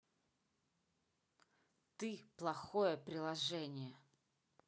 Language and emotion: Russian, angry